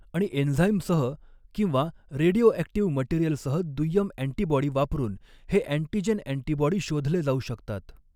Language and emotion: Marathi, neutral